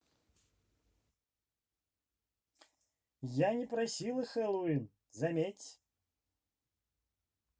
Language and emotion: Russian, neutral